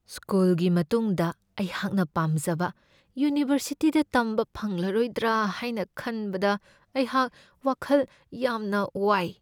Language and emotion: Manipuri, fearful